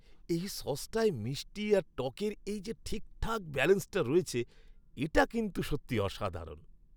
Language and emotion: Bengali, happy